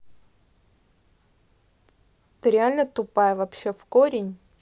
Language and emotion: Russian, angry